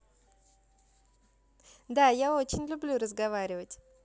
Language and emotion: Russian, positive